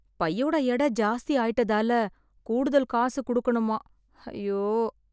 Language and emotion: Tamil, sad